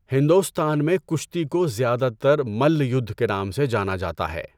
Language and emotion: Urdu, neutral